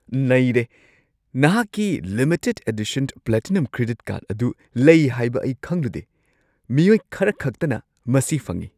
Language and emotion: Manipuri, surprised